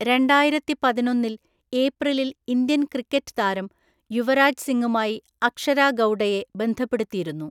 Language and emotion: Malayalam, neutral